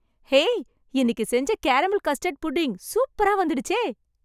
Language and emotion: Tamil, happy